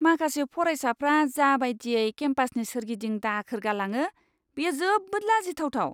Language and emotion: Bodo, disgusted